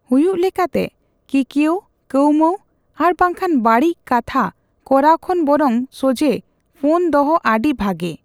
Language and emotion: Santali, neutral